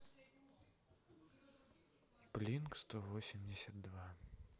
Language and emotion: Russian, neutral